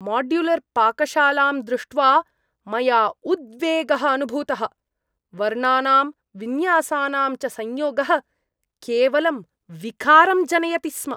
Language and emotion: Sanskrit, disgusted